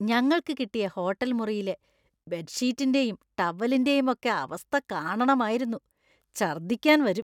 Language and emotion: Malayalam, disgusted